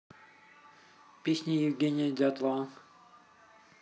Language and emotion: Russian, neutral